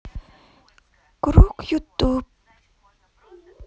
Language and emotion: Russian, sad